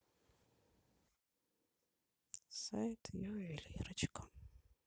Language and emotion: Russian, sad